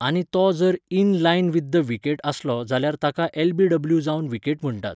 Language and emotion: Goan Konkani, neutral